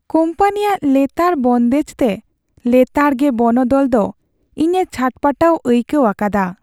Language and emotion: Santali, sad